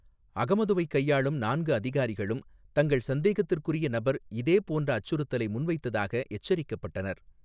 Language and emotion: Tamil, neutral